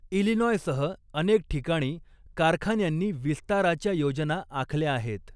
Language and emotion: Marathi, neutral